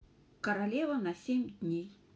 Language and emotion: Russian, neutral